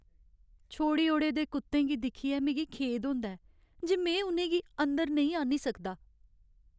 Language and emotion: Dogri, sad